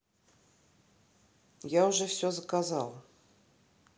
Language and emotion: Russian, neutral